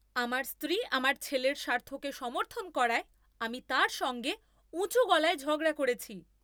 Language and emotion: Bengali, angry